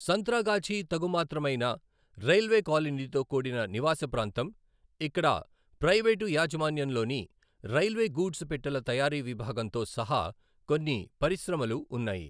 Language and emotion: Telugu, neutral